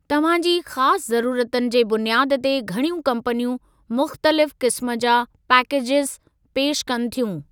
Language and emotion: Sindhi, neutral